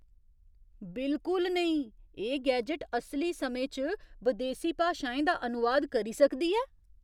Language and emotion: Dogri, surprised